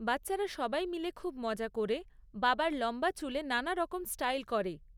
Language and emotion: Bengali, neutral